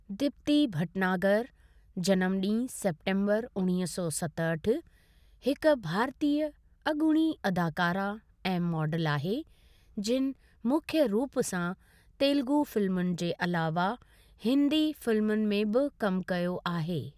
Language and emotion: Sindhi, neutral